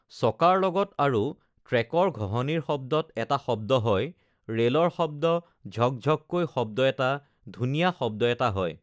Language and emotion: Assamese, neutral